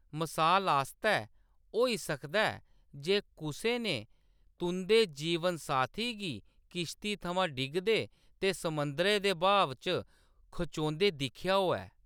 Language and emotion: Dogri, neutral